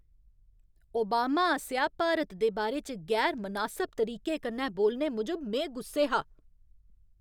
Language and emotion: Dogri, angry